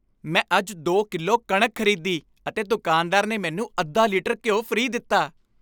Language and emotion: Punjabi, happy